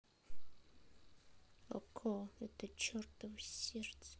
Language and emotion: Russian, sad